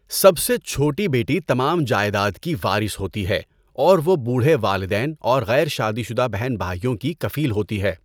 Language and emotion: Urdu, neutral